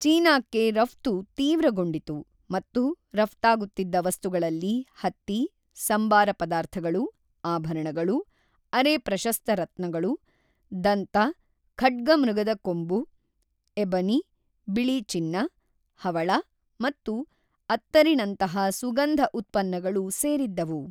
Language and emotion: Kannada, neutral